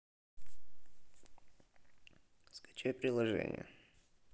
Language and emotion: Russian, neutral